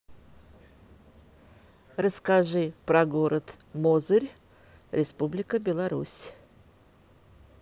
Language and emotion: Russian, neutral